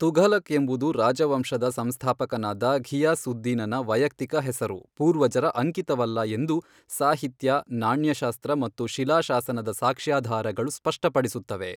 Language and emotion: Kannada, neutral